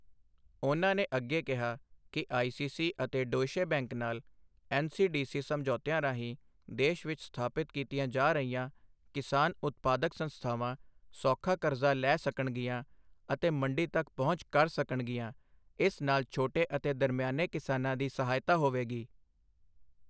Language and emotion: Punjabi, neutral